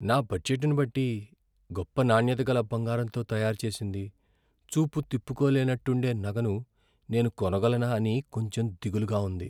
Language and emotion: Telugu, fearful